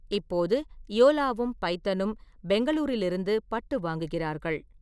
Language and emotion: Tamil, neutral